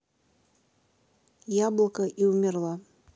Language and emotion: Russian, neutral